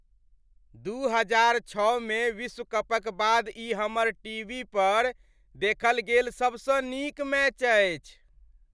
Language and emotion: Maithili, happy